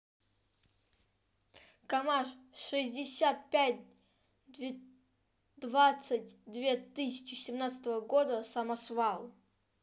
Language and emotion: Russian, neutral